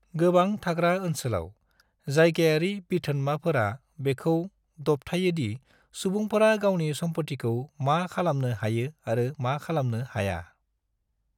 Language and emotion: Bodo, neutral